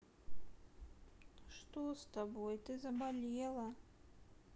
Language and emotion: Russian, sad